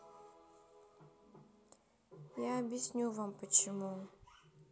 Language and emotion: Russian, sad